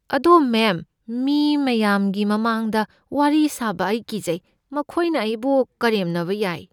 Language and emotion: Manipuri, fearful